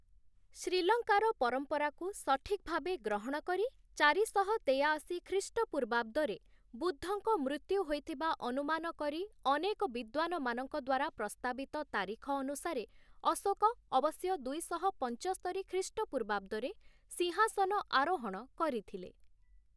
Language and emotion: Odia, neutral